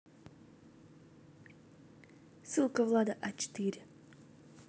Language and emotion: Russian, neutral